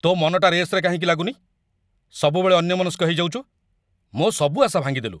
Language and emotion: Odia, angry